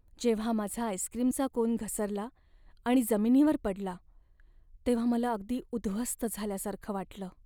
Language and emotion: Marathi, sad